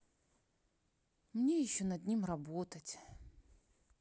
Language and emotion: Russian, sad